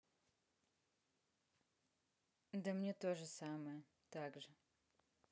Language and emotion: Russian, neutral